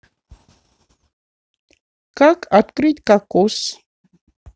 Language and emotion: Russian, neutral